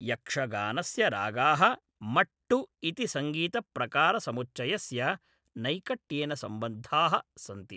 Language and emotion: Sanskrit, neutral